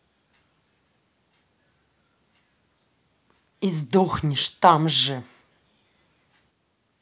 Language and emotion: Russian, angry